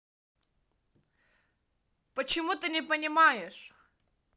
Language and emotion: Russian, angry